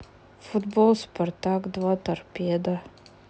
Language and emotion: Russian, sad